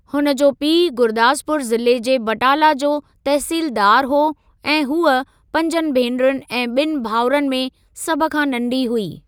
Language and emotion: Sindhi, neutral